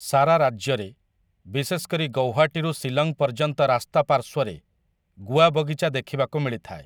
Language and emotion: Odia, neutral